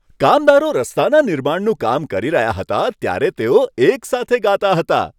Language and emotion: Gujarati, happy